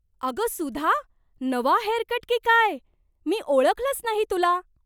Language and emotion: Marathi, surprised